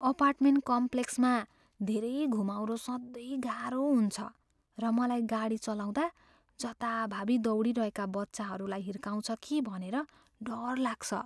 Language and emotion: Nepali, fearful